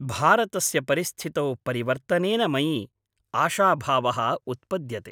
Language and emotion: Sanskrit, happy